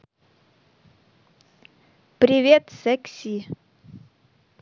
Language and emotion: Russian, neutral